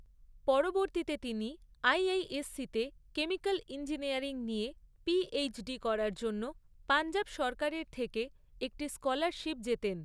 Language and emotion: Bengali, neutral